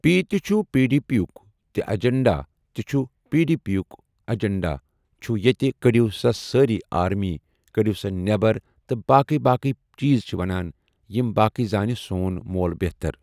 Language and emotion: Kashmiri, neutral